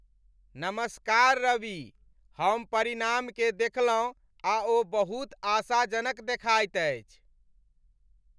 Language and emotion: Maithili, happy